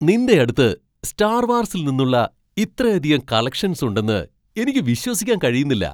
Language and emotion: Malayalam, surprised